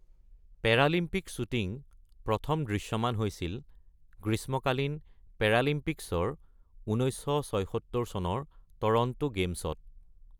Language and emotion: Assamese, neutral